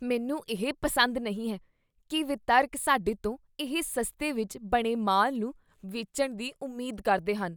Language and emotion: Punjabi, disgusted